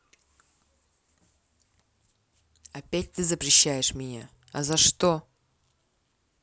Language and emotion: Russian, angry